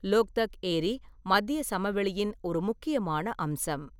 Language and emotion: Tamil, neutral